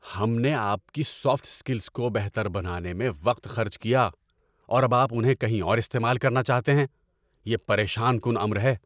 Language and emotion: Urdu, angry